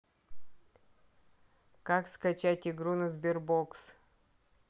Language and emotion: Russian, neutral